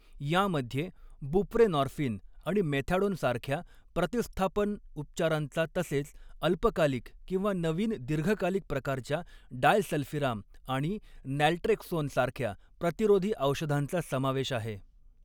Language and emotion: Marathi, neutral